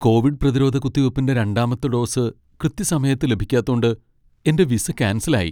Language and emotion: Malayalam, sad